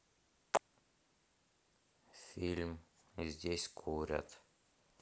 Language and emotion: Russian, neutral